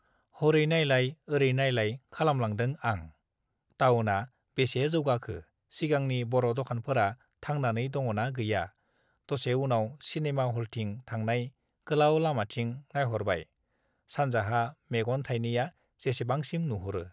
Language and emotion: Bodo, neutral